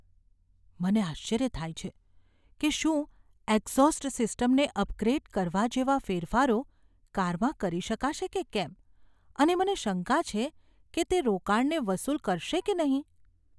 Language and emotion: Gujarati, fearful